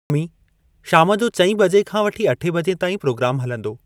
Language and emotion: Sindhi, neutral